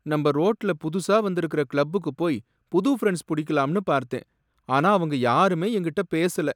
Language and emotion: Tamil, sad